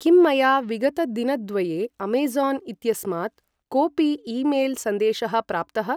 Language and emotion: Sanskrit, neutral